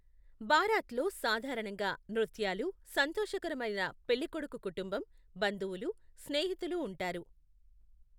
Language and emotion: Telugu, neutral